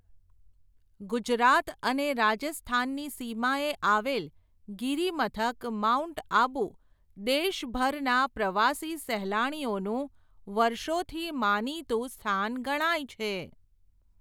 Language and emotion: Gujarati, neutral